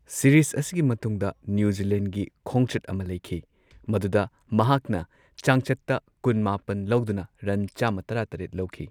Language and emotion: Manipuri, neutral